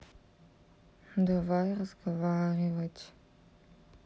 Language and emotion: Russian, sad